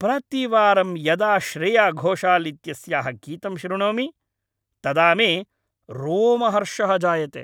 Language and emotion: Sanskrit, happy